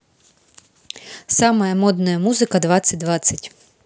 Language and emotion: Russian, positive